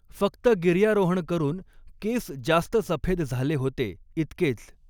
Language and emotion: Marathi, neutral